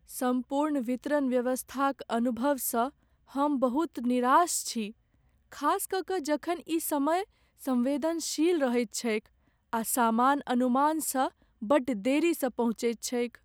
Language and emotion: Maithili, sad